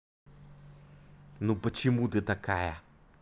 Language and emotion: Russian, angry